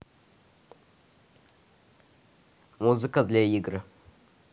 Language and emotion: Russian, neutral